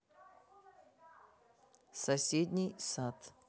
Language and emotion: Russian, neutral